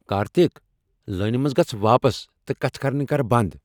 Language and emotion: Kashmiri, angry